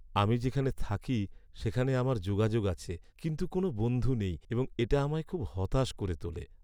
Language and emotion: Bengali, sad